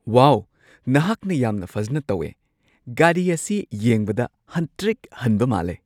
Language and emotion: Manipuri, surprised